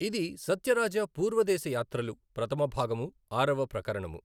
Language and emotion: Telugu, neutral